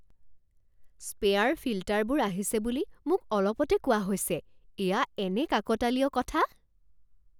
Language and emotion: Assamese, surprised